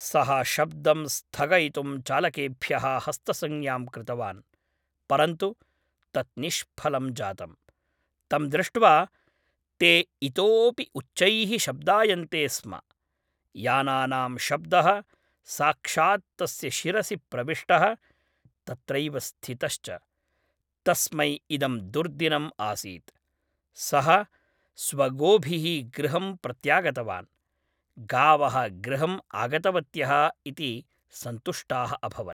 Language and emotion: Sanskrit, neutral